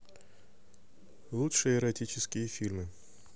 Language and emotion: Russian, neutral